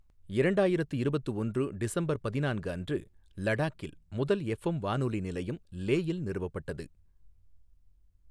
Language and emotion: Tamil, neutral